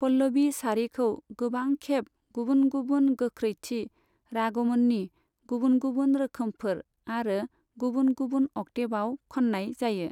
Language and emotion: Bodo, neutral